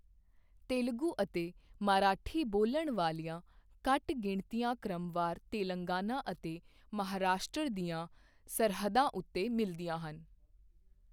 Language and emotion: Punjabi, neutral